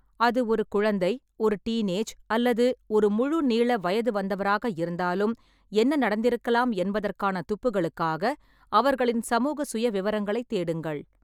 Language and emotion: Tamil, neutral